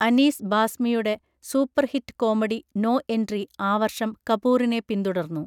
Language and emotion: Malayalam, neutral